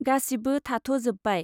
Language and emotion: Bodo, neutral